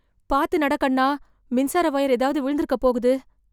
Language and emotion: Tamil, fearful